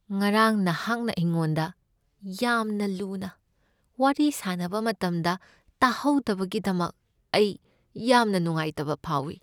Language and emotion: Manipuri, sad